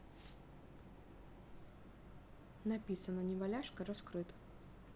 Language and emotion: Russian, neutral